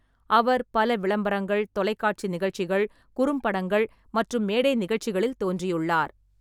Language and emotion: Tamil, neutral